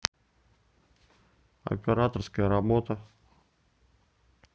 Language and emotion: Russian, neutral